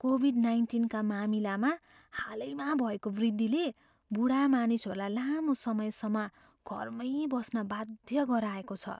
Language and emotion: Nepali, fearful